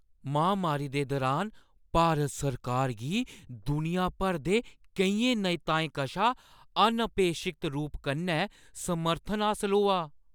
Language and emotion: Dogri, surprised